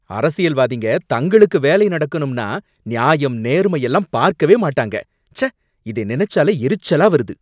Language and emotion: Tamil, angry